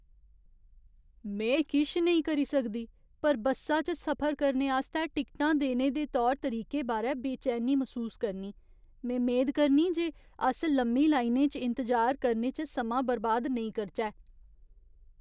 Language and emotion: Dogri, fearful